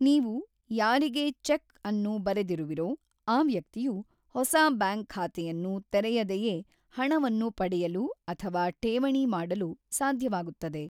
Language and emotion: Kannada, neutral